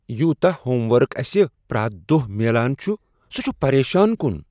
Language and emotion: Kashmiri, disgusted